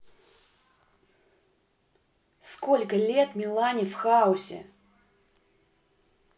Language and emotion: Russian, angry